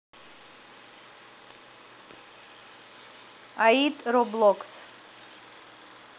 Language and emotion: Russian, neutral